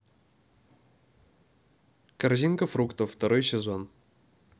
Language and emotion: Russian, neutral